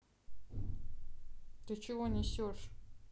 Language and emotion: Russian, angry